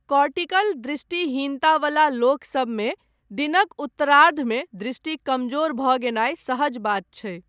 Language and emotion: Maithili, neutral